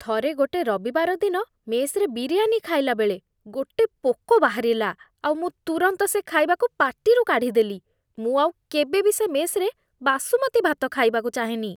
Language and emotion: Odia, disgusted